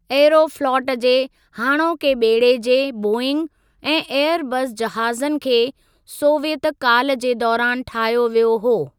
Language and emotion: Sindhi, neutral